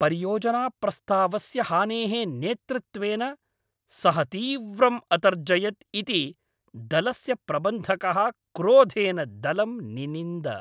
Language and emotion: Sanskrit, angry